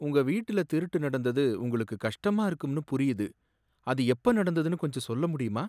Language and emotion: Tamil, sad